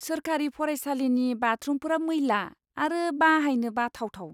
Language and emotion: Bodo, disgusted